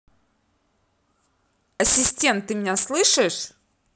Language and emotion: Russian, angry